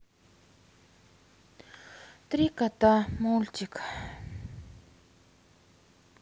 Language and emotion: Russian, sad